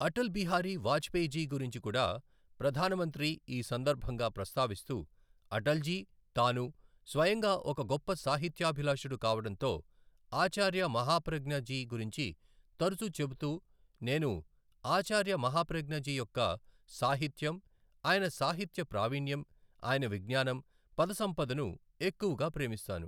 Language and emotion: Telugu, neutral